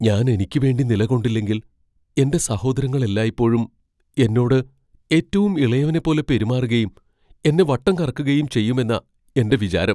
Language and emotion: Malayalam, fearful